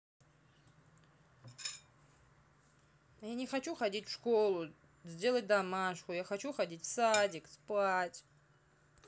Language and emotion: Russian, sad